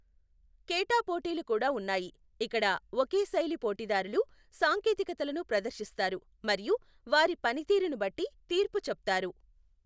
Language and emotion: Telugu, neutral